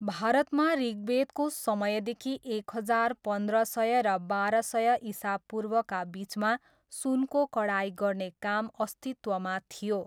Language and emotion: Nepali, neutral